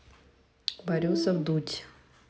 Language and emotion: Russian, neutral